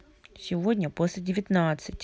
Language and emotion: Russian, neutral